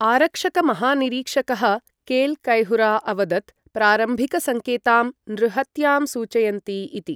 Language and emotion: Sanskrit, neutral